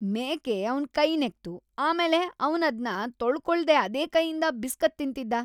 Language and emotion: Kannada, disgusted